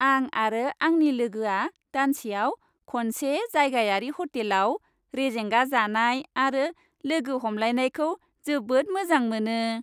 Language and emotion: Bodo, happy